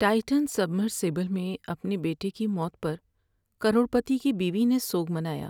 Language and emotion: Urdu, sad